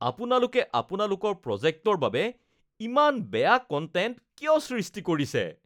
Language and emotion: Assamese, disgusted